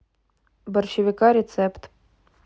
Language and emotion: Russian, neutral